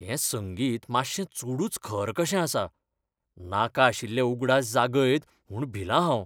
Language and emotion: Goan Konkani, fearful